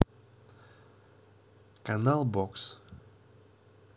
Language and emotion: Russian, neutral